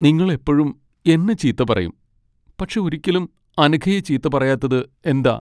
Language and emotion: Malayalam, sad